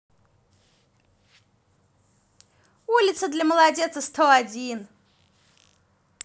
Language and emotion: Russian, positive